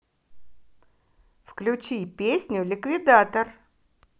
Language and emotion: Russian, positive